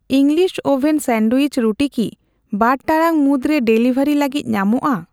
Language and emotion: Santali, neutral